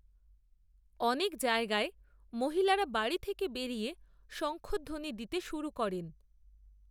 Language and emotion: Bengali, neutral